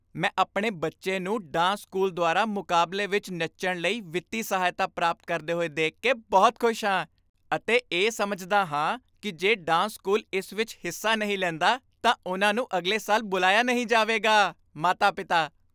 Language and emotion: Punjabi, happy